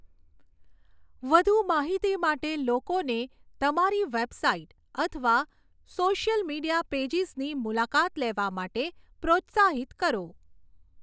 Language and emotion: Gujarati, neutral